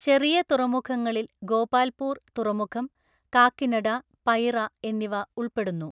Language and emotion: Malayalam, neutral